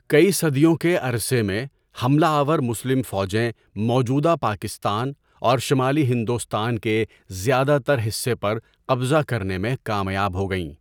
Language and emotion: Urdu, neutral